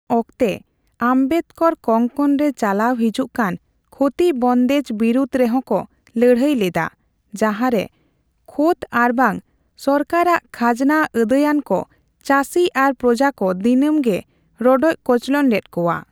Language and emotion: Santali, neutral